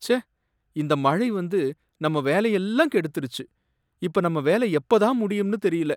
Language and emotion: Tamil, sad